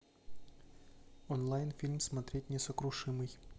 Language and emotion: Russian, neutral